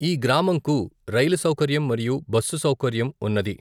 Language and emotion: Telugu, neutral